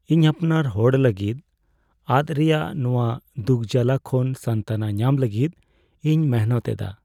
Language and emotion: Santali, sad